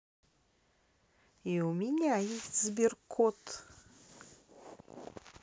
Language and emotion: Russian, neutral